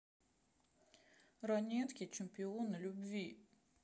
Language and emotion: Russian, sad